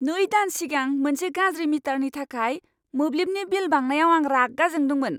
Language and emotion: Bodo, angry